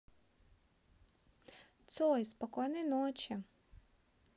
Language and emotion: Russian, neutral